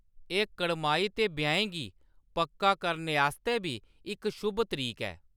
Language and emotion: Dogri, neutral